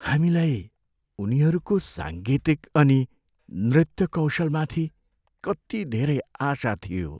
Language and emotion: Nepali, sad